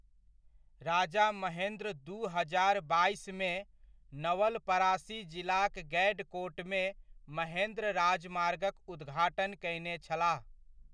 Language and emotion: Maithili, neutral